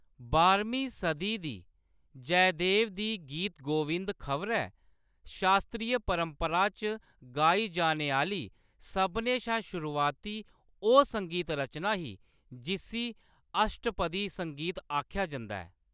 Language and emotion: Dogri, neutral